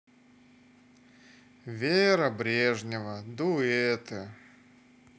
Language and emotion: Russian, sad